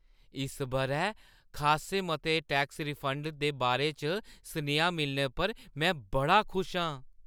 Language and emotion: Dogri, happy